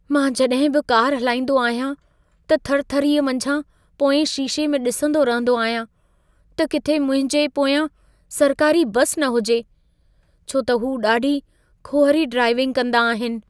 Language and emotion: Sindhi, fearful